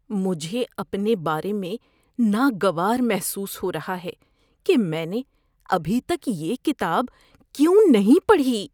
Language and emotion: Urdu, disgusted